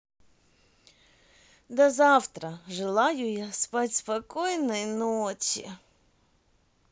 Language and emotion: Russian, positive